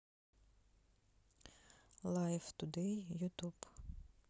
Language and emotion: Russian, neutral